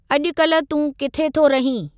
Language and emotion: Sindhi, neutral